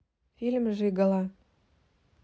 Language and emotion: Russian, neutral